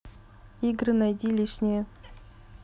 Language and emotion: Russian, neutral